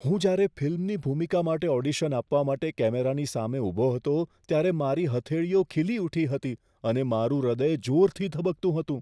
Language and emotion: Gujarati, fearful